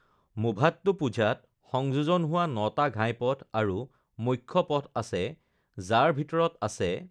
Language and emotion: Assamese, neutral